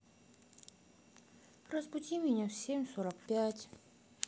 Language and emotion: Russian, sad